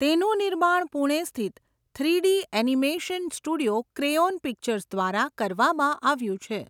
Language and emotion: Gujarati, neutral